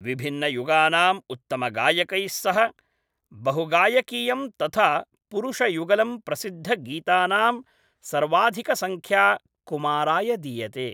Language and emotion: Sanskrit, neutral